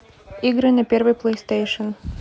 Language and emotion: Russian, neutral